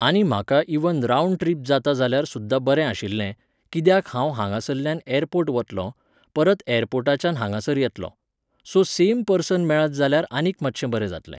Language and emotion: Goan Konkani, neutral